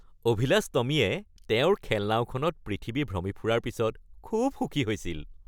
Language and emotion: Assamese, happy